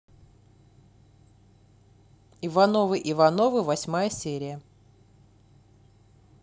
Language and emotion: Russian, neutral